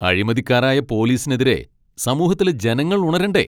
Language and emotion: Malayalam, angry